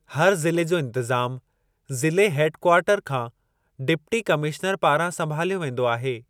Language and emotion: Sindhi, neutral